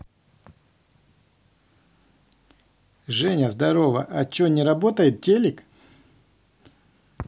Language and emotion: Russian, neutral